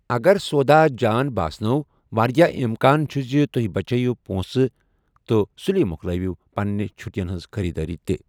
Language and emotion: Kashmiri, neutral